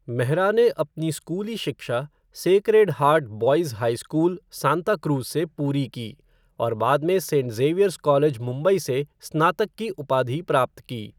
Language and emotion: Hindi, neutral